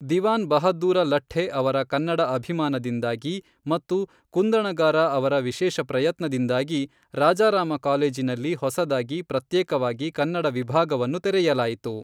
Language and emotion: Kannada, neutral